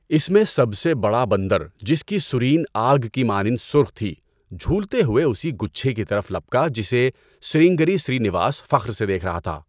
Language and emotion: Urdu, neutral